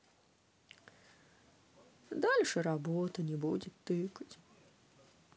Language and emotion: Russian, sad